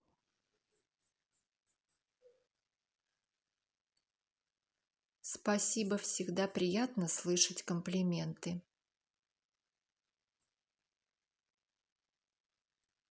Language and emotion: Russian, neutral